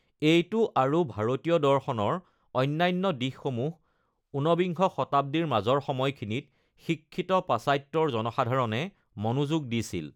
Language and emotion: Assamese, neutral